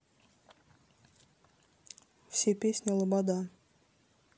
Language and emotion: Russian, neutral